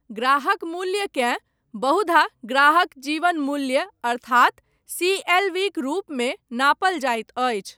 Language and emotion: Maithili, neutral